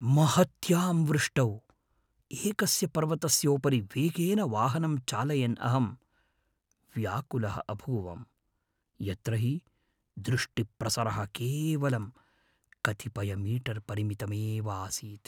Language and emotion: Sanskrit, fearful